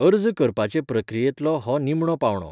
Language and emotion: Goan Konkani, neutral